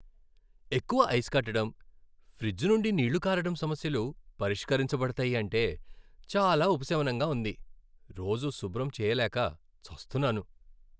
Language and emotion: Telugu, happy